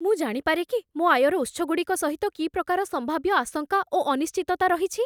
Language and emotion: Odia, fearful